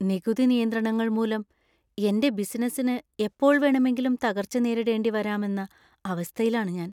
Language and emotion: Malayalam, fearful